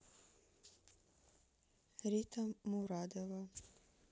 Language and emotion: Russian, neutral